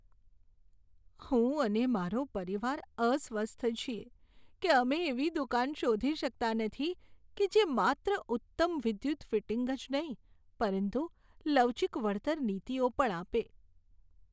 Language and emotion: Gujarati, sad